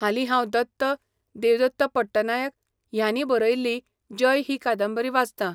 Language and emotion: Goan Konkani, neutral